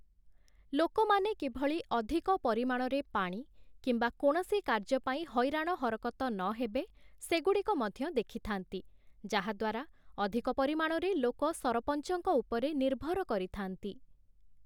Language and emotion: Odia, neutral